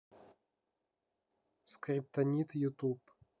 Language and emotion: Russian, neutral